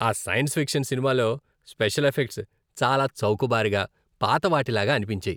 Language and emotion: Telugu, disgusted